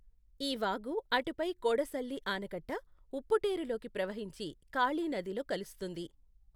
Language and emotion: Telugu, neutral